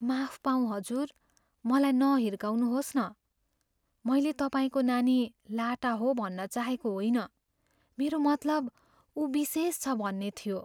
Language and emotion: Nepali, fearful